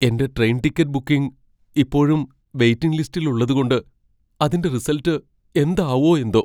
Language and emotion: Malayalam, fearful